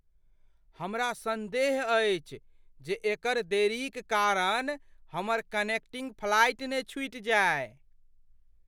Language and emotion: Maithili, fearful